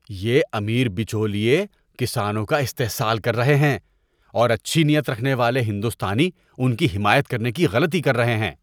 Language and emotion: Urdu, disgusted